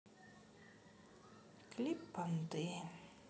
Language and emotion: Russian, sad